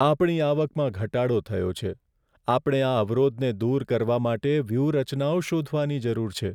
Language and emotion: Gujarati, sad